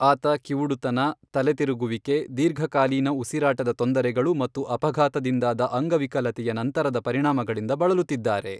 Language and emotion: Kannada, neutral